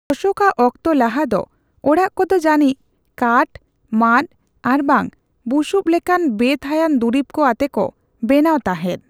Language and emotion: Santali, neutral